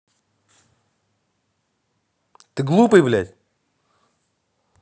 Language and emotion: Russian, angry